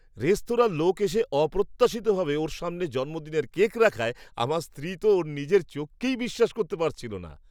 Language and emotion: Bengali, surprised